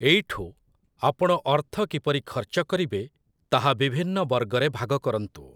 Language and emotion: Odia, neutral